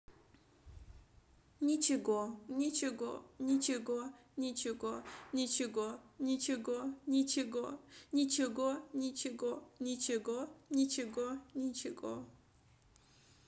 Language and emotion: Russian, sad